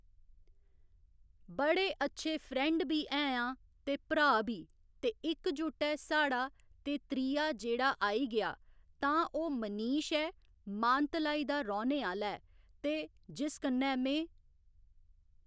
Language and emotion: Dogri, neutral